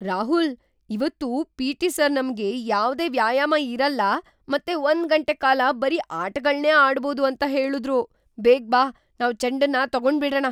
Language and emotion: Kannada, surprised